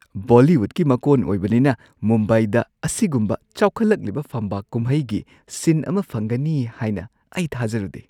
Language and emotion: Manipuri, surprised